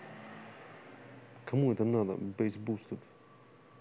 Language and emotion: Russian, angry